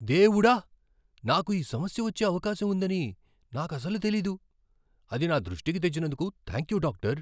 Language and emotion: Telugu, surprised